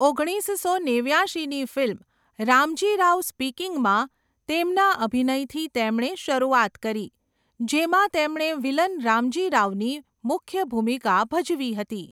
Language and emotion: Gujarati, neutral